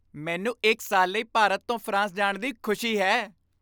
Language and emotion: Punjabi, happy